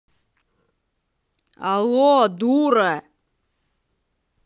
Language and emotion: Russian, angry